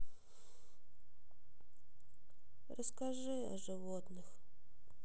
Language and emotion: Russian, sad